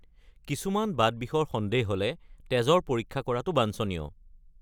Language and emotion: Assamese, neutral